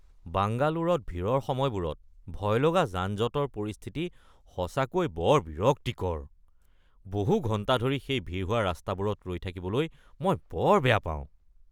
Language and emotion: Assamese, disgusted